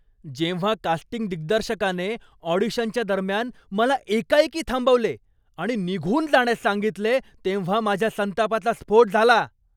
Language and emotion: Marathi, angry